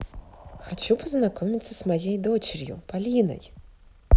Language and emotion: Russian, positive